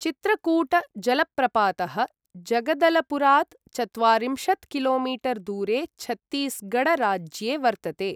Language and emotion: Sanskrit, neutral